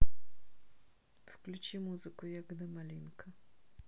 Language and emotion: Russian, neutral